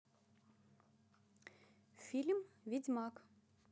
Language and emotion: Russian, neutral